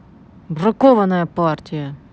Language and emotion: Russian, angry